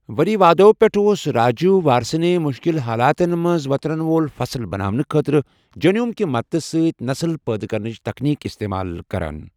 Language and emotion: Kashmiri, neutral